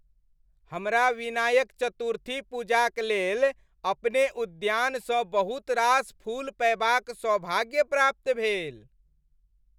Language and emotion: Maithili, happy